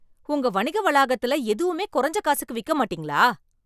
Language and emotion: Tamil, angry